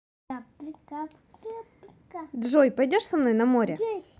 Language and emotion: Russian, positive